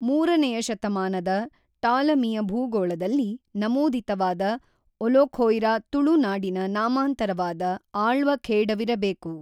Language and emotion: Kannada, neutral